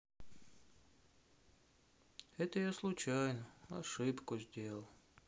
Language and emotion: Russian, sad